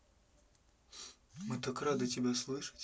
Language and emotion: Russian, neutral